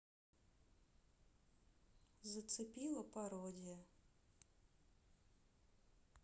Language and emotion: Russian, neutral